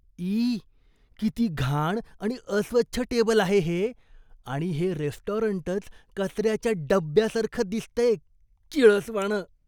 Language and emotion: Marathi, disgusted